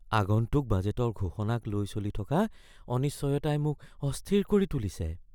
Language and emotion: Assamese, fearful